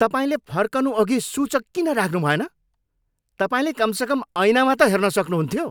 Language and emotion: Nepali, angry